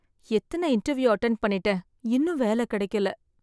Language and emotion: Tamil, sad